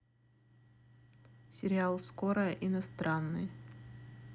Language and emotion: Russian, neutral